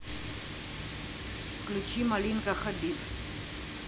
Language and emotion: Russian, neutral